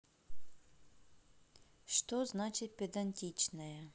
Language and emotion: Russian, neutral